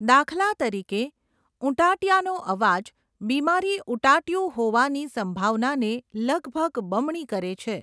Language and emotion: Gujarati, neutral